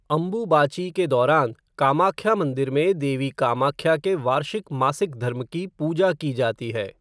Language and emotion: Hindi, neutral